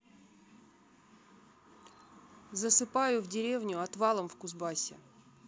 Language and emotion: Russian, neutral